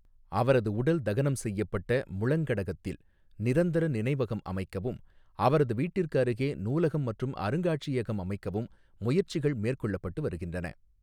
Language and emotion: Tamil, neutral